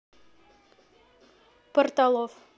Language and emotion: Russian, neutral